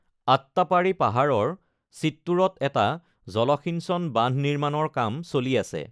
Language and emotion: Assamese, neutral